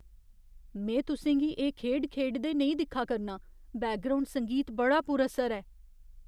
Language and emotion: Dogri, fearful